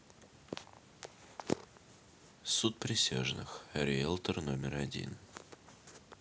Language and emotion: Russian, neutral